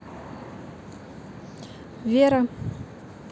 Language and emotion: Russian, neutral